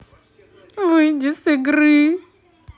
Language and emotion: Russian, sad